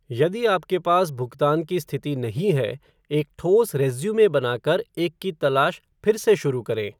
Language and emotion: Hindi, neutral